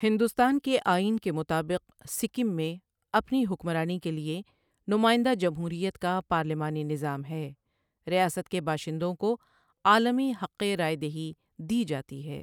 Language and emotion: Urdu, neutral